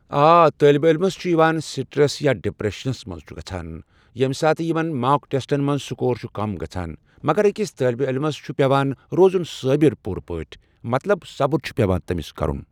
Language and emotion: Kashmiri, neutral